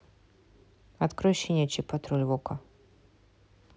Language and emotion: Russian, neutral